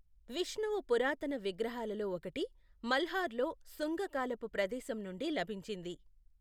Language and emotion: Telugu, neutral